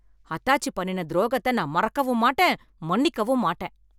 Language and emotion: Tamil, angry